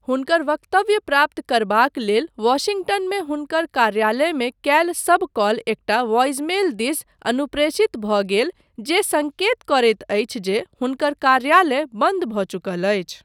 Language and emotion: Maithili, neutral